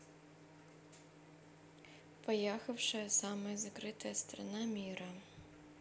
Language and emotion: Russian, neutral